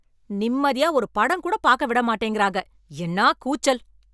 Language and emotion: Tamil, angry